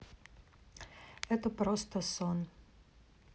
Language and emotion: Russian, neutral